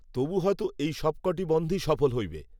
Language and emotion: Bengali, neutral